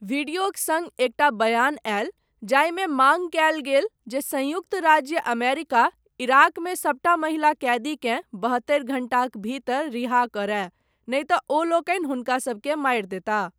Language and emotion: Maithili, neutral